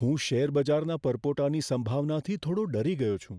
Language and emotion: Gujarati, fearful